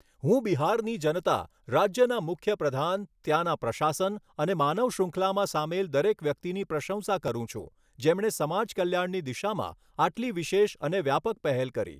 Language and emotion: Gujarati, neutral